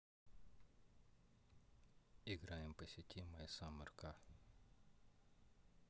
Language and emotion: Russian, neutral